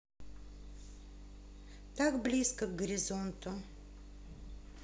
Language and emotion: Russian, neutral